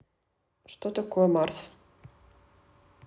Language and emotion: Russian, neutral